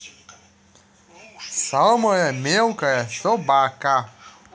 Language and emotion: Russian, neutral